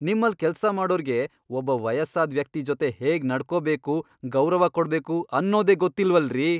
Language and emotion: Kannada, angry